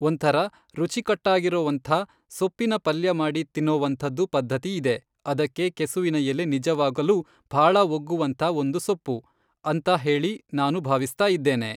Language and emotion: Kannada, neutral